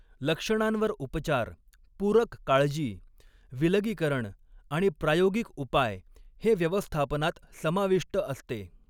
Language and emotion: Marathi, neutral